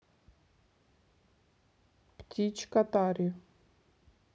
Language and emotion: Russian, neutral